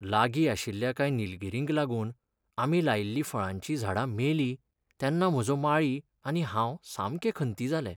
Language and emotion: Goan Konkani, sad